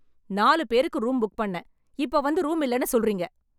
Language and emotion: Tamil, angry